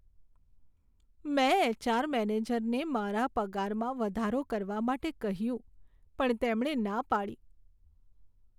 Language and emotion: Gujarati, sad